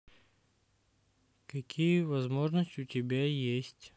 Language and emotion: Russian, neutral